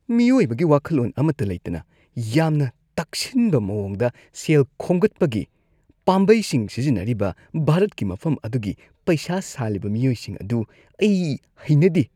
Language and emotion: Manipuri, disgusted